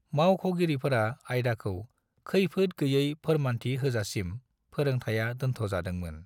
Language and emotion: Bodo, neutral